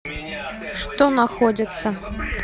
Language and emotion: Russian, neutral